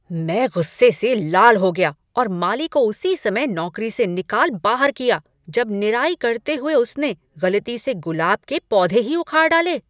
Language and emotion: Hindi, angry